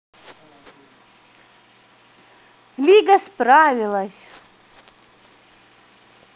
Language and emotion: Russian, positive